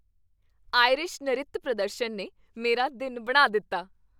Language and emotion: Punjabi, happy